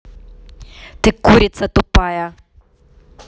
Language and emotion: Russian, angry